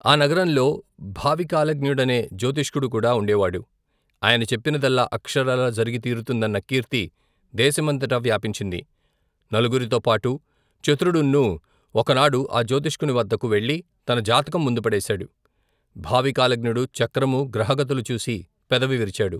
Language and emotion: Telugu, neutral